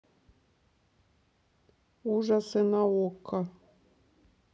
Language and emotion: Russian, neutral